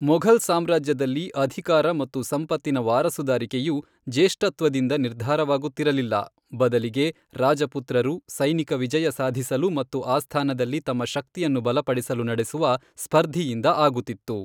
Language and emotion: Kannada, neutral